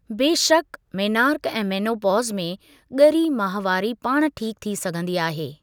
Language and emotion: Sindhi, neutral